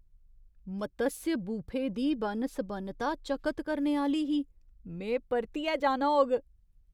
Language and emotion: Dogri, surprised